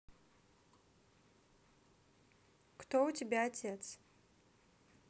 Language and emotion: Russian, neutral